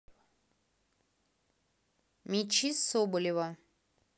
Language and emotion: Russian, neutral